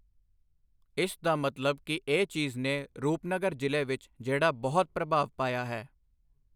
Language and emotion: Punjabi, neutral